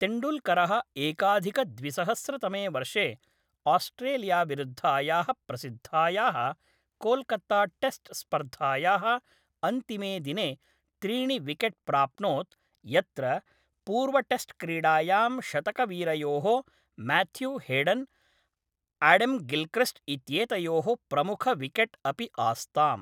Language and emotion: Sanskrit, neutral